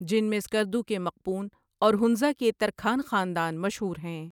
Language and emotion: Urdu, neutral